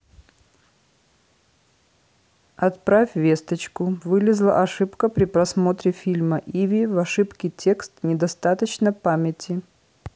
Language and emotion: Russian, neutral